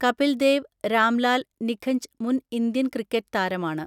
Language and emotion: Malayalam, neutral